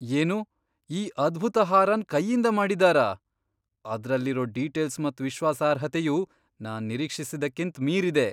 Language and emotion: Kannada, surprised